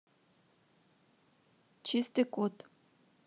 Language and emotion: Russian, neutral